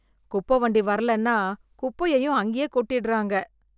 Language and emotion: Tamil, disgusted